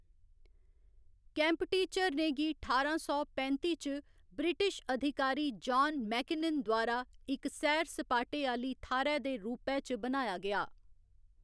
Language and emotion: Dogri, neutral